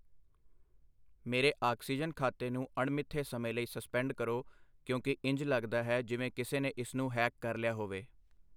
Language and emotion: Punjabi, neutral